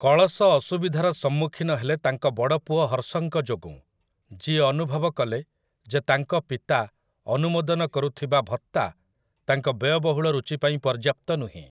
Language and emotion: Odia, neutral